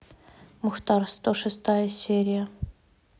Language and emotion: Russian, neutral